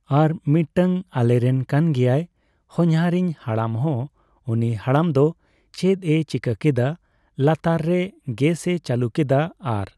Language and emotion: Santali, neutral